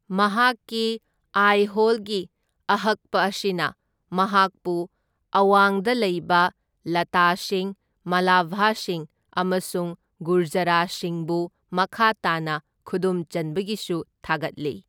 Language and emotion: Manipuri, neutral